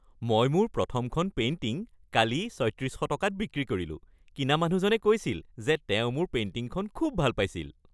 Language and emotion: Assamese, happy